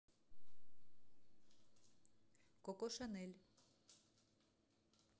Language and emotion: Russian, neutral